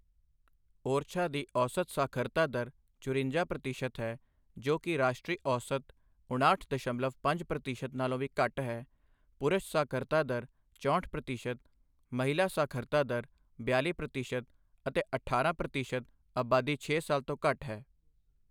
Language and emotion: Punjabi, neutral